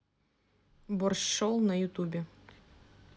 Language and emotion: Russian, neutral